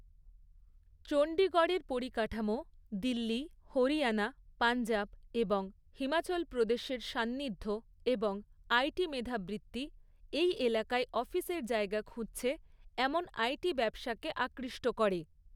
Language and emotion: Bengali, neutral